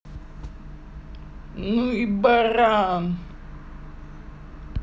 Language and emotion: Russian, angry